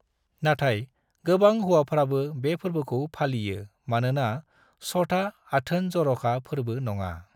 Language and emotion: Bodo, neutral